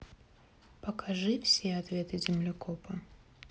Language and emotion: Russian, neutral